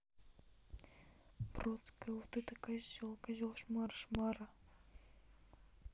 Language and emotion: Russian, neutral